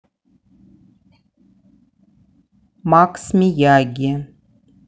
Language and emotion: Russian, neutral